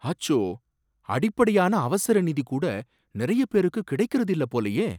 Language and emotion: Tamil, surprised